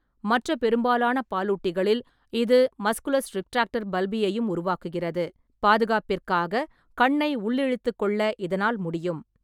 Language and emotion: Tamil, neutral